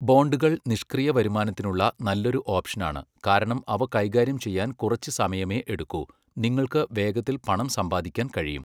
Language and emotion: Malayalam, neutral